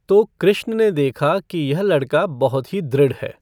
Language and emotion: Hindi, neutral